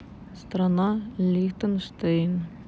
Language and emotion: Russian, neutral